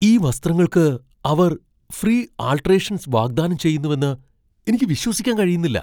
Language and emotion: Malayalam, surprised